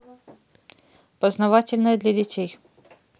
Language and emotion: Russian, neutral